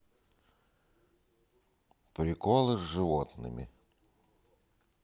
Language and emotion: Russian, neutral